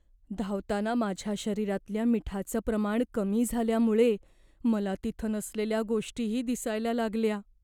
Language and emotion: Marathi, fearful